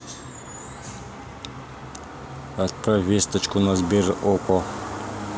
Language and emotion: Russian, neutral